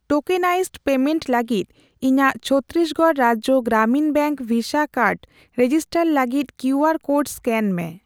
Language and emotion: Santali, neutral